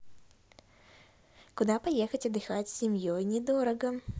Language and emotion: Russian, positive